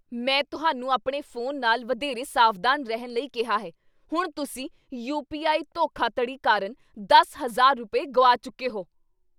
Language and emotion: Punjabi, angry